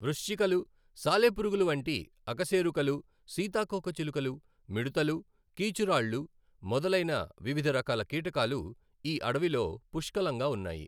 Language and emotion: Telugu, neutral